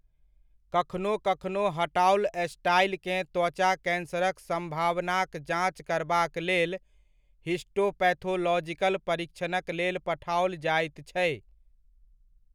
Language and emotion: Maithili, neutral